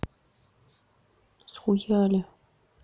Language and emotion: Russian, neutral